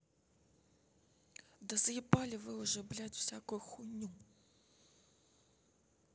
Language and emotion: Russian, angry